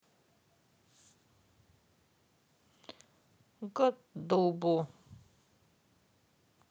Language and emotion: Russian, sad